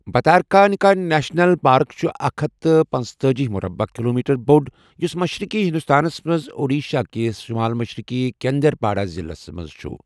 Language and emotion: Kashmiri, neutral